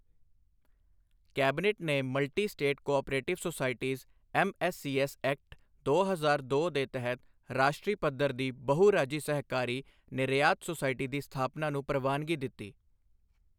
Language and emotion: Punjabi, neutral